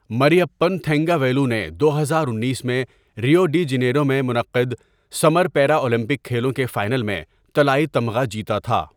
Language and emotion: Urdu, neutral